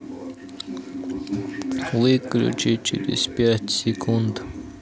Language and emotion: Russian, neutral